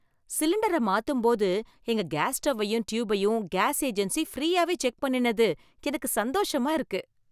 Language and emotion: Tamil, happy